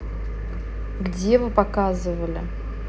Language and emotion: Russian, neutral